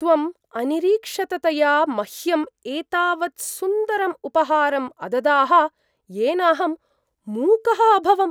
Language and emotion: Sanskrit, surprised